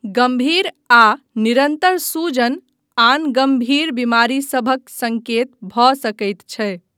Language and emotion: Maithili, neutral